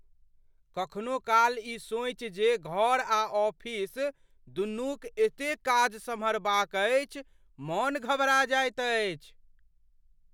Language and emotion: Maithili, fearful